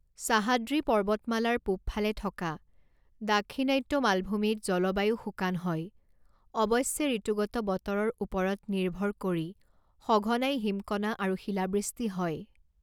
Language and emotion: Assamese, neutral